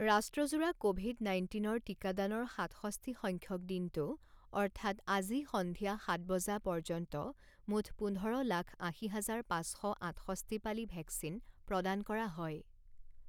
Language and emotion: Assamese, neutral